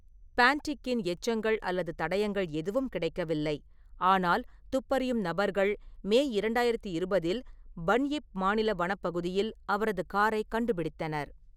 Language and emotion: Tamil, neutral